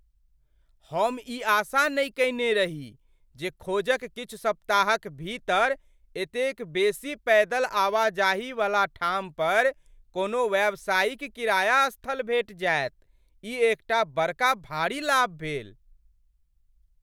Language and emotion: Maithili, surprised